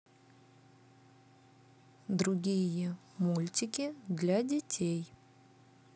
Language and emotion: Russian, neutral